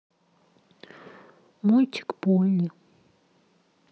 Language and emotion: Russian, neutral